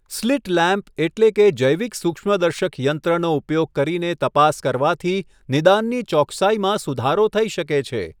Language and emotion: Gujarati, neutral